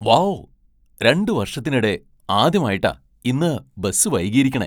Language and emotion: Malayalam, surprised